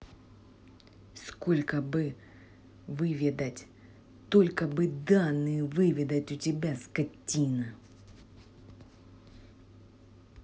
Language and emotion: Russian, angry